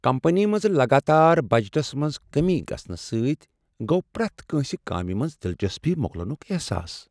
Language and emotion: Kashmiri, sad